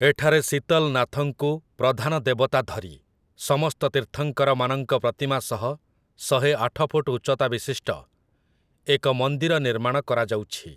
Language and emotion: Odia, neutral